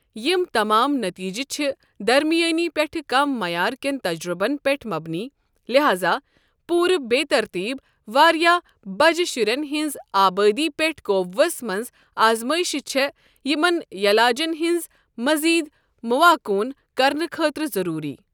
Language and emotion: Kashmiri, neutral